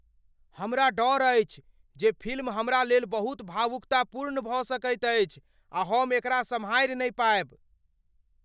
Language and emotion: Maithili, fearful